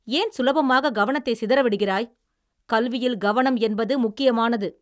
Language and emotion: Tamil, angry